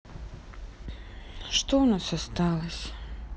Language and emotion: Russian, sad